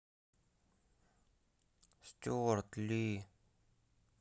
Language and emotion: Russian, sad